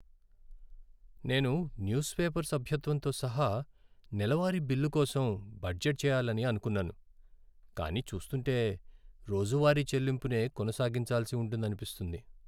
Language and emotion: Telugu, sad